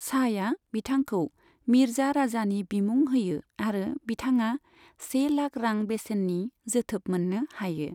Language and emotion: Bodo, neutral